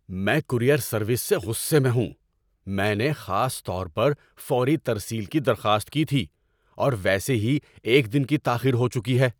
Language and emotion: Urdu, angry